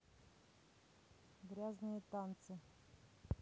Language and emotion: Russian, neutral